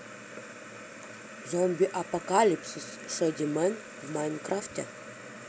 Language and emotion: Russian, positive